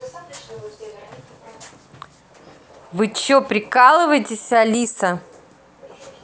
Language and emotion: Russian, angry